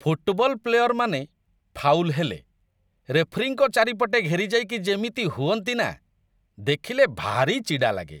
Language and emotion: Odia, disgusted